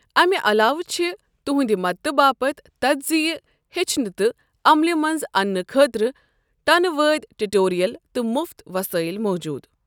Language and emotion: Kashmiri, neutral